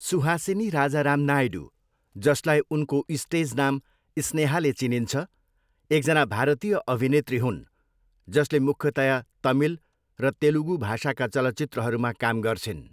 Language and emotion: Nepali, neutral